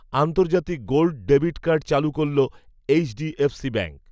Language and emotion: Bengali, neutral